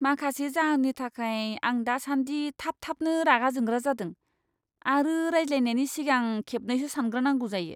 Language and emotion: Bodo, disgusted